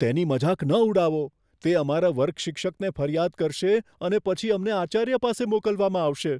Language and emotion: Gujarati, fearful